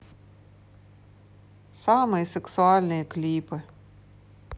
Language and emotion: Russian, neutral